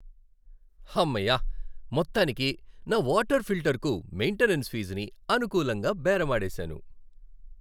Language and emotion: Telugu, happy